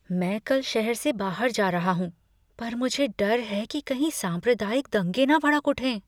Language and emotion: Hindi, fearful